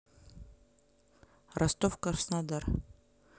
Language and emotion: Russian, neutral